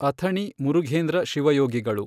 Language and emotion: Kannada, neutral